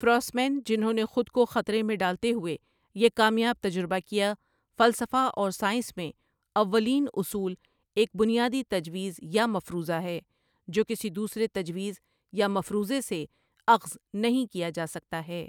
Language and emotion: Urdu, neutral